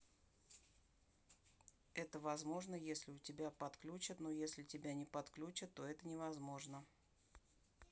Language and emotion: Russian, neutral